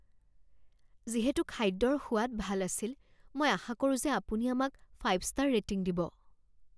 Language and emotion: Assamese, fearful